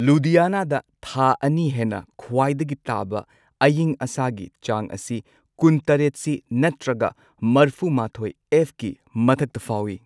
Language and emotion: Manipuri, neutral